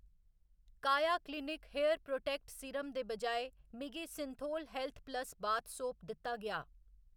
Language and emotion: Dogri, neutral